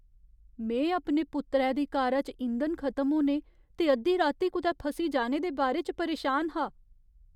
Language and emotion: Dogri, fearful